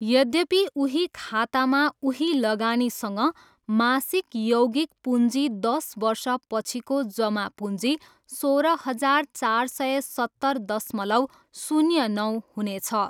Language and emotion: Nepali, neutral